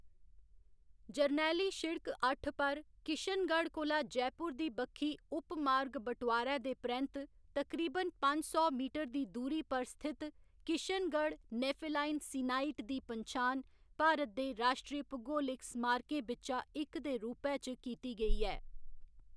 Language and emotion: Dogri, neutral